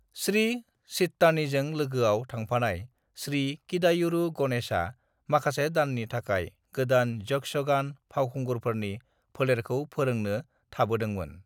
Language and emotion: Bodo, neutral